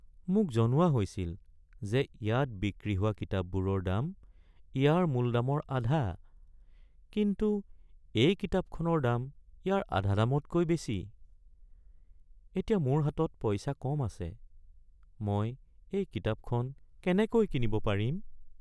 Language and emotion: Assamese, sad